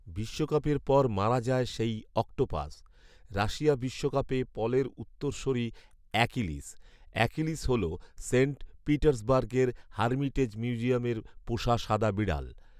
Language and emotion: Bengali, neutral